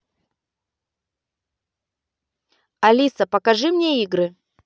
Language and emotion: Russian, neutral